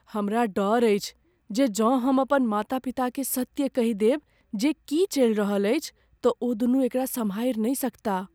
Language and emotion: Maithili, fearful